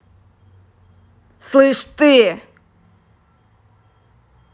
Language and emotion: Russian, angry